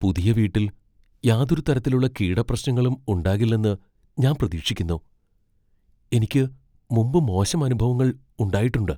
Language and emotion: Malayalam, fearful